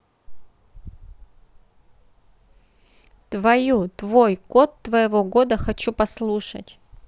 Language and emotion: Russian, neutral